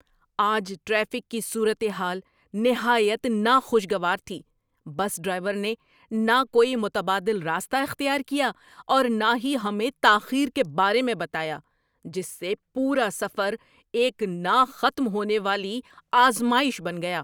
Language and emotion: Urdu, angry